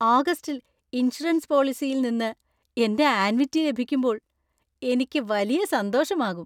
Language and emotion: Malayalam, happy